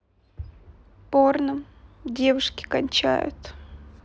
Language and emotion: Russian, neutral